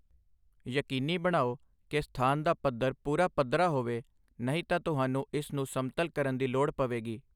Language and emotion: Punjabi, neutral